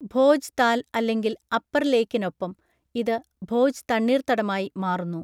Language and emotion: Malayalam, neutral